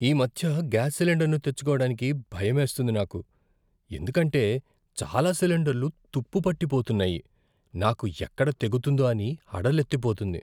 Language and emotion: Telugu, fearful